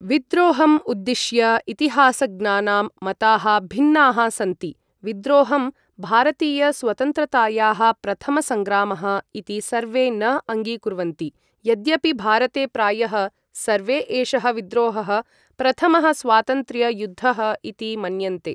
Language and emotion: Sanskrit, neutral